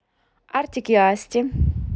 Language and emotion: Russian, neutral